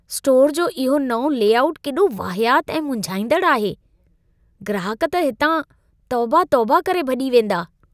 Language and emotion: Sindhi, disgusted